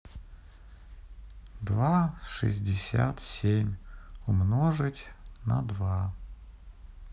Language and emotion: Russian, sad